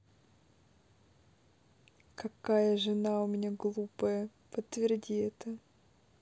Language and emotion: Russian, neutral